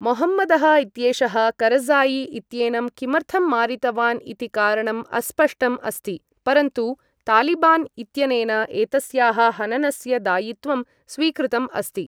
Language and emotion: Sanskrit, neutral